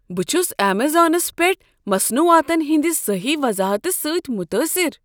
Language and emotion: Kashmiri, surprised